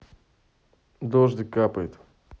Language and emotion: Russian, neutral